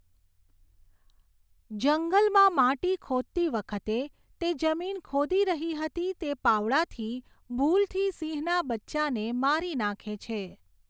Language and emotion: Gujarati, neutral